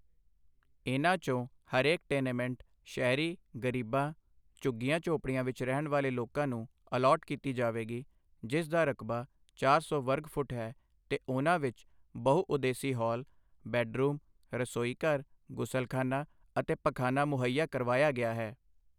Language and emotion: Punjabi, neutral